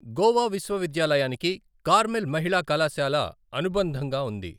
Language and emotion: Telugu, neutral